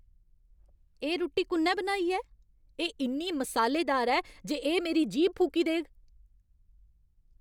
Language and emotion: Dogri, angry